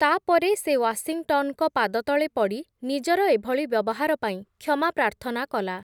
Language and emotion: Odia, neutral